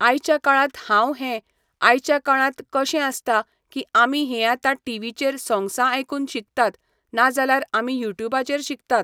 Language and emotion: Goan Konkani, neutral